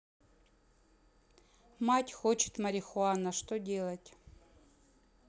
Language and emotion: Russian, neutral